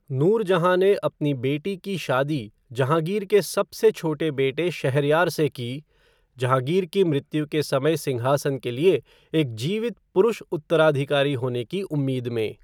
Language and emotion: Hindi, neutral